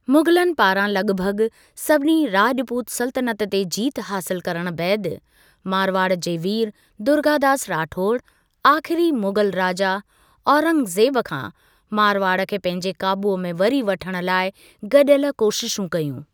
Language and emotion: Sindhi, neutral